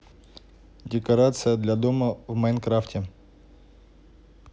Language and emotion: Russian, neutral